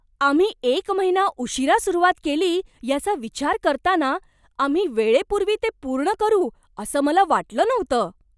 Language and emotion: Marathi, surprised